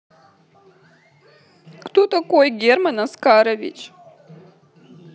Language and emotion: Russian, sad